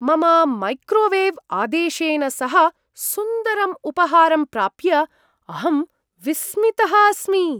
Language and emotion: Sanskrit, surprised